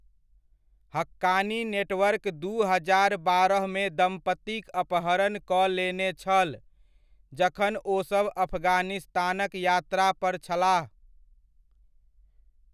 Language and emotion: Maithili, neutral